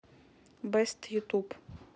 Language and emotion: Russian, neutral